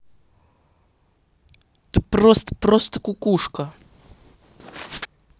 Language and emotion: Russian, angry